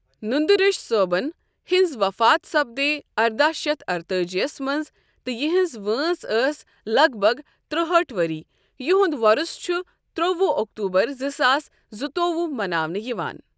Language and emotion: Kashmiri, neutral